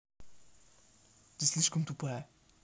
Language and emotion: Russian, angry